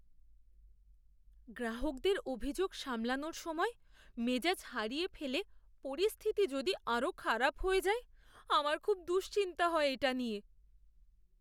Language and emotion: Bengali, fearful